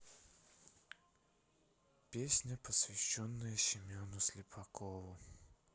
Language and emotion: Russian, sad